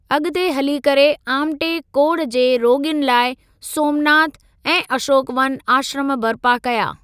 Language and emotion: Sindhi, neutral